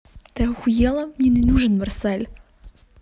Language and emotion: Russian, angry